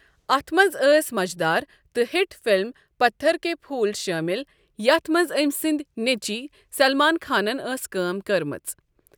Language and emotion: Kashmiri, neutral